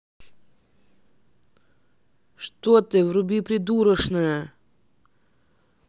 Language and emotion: Russian, angry